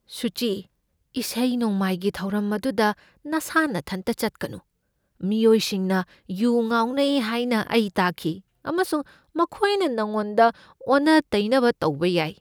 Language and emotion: Manipuri, fearful